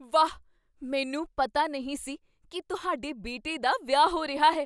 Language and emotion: Punjabi, surprised